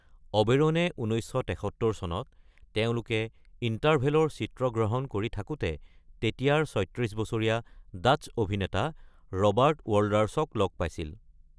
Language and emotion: Assamese, neutral